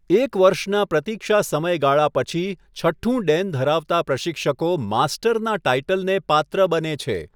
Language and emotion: Gujarati, neutral